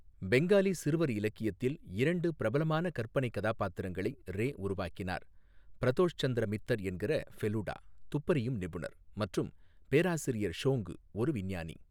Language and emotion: Tamil, neutral